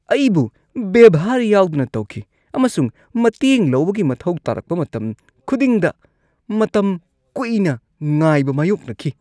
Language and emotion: Manipuri, disgusted